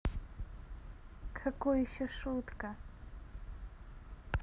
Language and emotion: Russian, positive